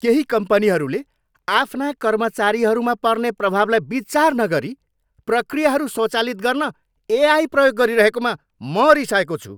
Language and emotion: Nepali, angry